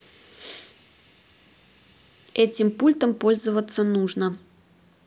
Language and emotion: Russian, neutral